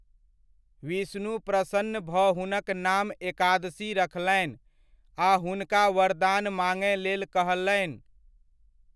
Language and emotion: Maithili, neutral